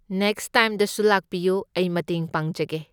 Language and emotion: Manipuri, neutral